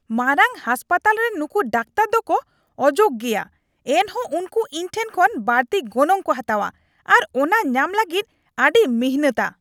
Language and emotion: Santali, angry